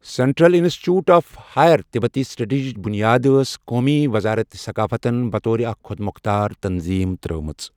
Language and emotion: Kashmiri, neutral